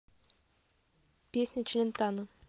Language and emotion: Russian, neutral